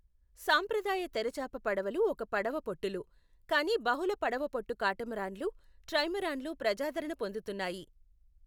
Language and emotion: Telugu, neutral